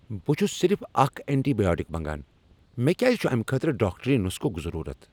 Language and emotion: Kashmiri, angry